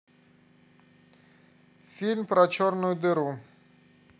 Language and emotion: Russian, neutral